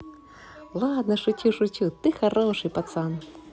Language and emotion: Russian, positive